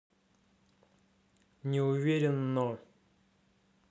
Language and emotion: Russian, neutral